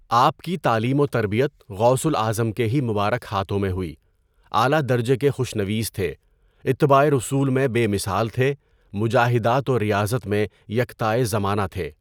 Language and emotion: Urdu, neutral